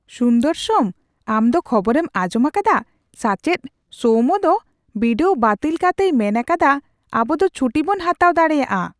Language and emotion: Santali, surprised